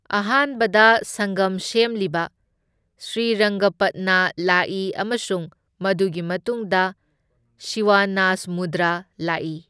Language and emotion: Manipuri, neutral